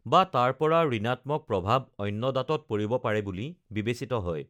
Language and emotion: Assamese, neutral